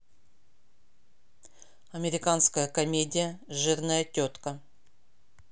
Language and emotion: Russian, neutral